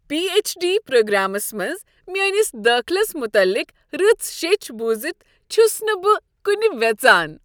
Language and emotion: Kashmiri, happy